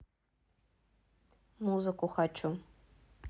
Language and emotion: Russian, neutral